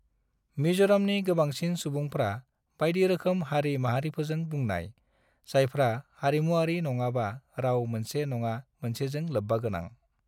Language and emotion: Bodo, neutral